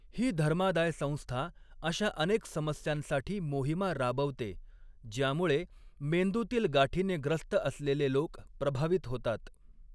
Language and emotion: Marathi, neutral